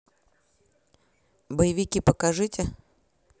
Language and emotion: Russian, neutral